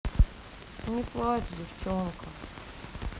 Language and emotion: Russian, sad